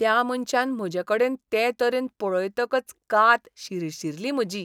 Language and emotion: Goan Konkani, disgusted